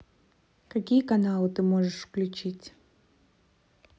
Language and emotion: Russian, neutral